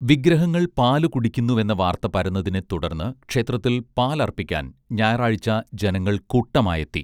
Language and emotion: Malayalam, neutral